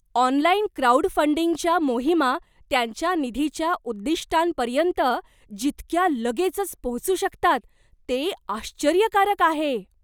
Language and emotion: Marathi, surprised